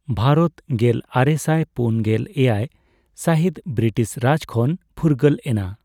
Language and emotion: Santali, neutral